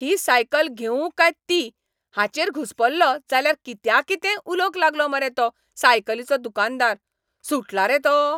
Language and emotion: Goan Konkani, angry